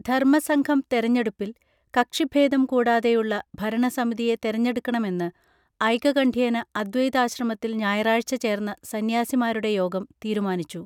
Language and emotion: Malayalam, neutral